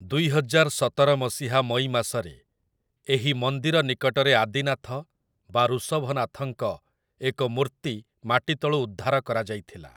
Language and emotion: Odia, neutral